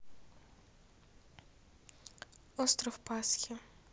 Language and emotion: Russian, neutral